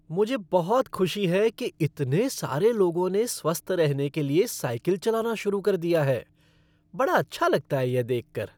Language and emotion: Hindi, happy